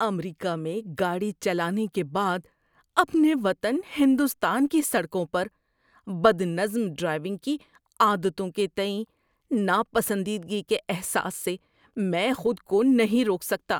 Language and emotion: Urdu, disgusted